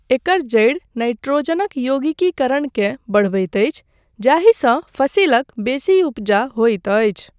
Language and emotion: Maithili, neutral